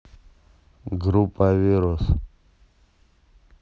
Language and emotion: Russian, neutral